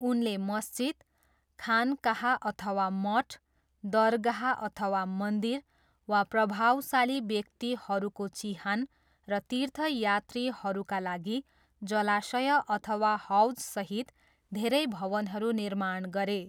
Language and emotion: Nepali, neutral